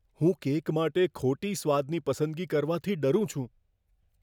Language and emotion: Gujarati, fearful